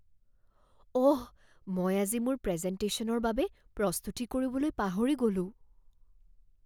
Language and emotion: Assamese, fearful